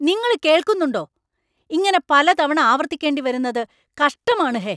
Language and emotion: Malayalam, angry